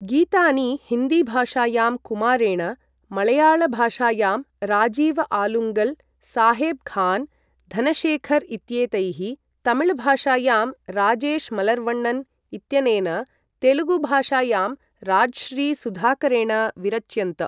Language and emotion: Sanskrit, neutral